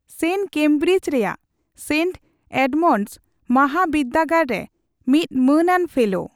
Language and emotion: Santali, neutral